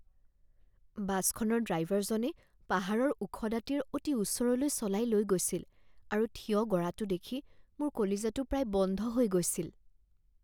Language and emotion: Assamese, fearful